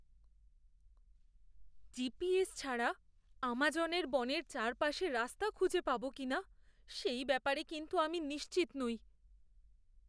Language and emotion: Bengali, fearful